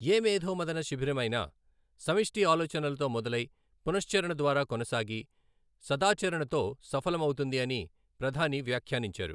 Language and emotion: Telugu, neutral